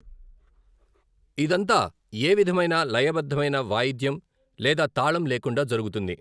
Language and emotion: Telugu, neutral